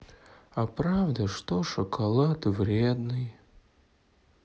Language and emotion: Russian, sad